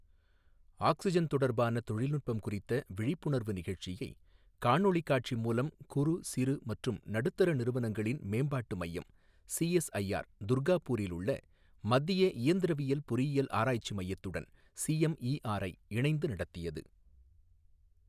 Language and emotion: Tamil, neutral